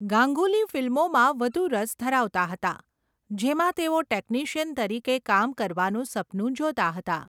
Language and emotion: Gujarati, neutral